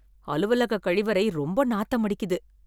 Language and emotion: Tamil, disgusted